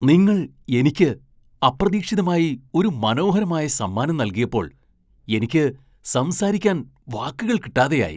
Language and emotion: Malayalam, surprised